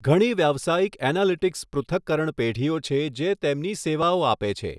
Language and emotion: Gujarati, neutral